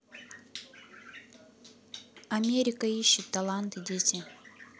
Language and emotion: Russian, neutral